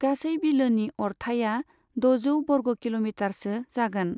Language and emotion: Bodo, neutral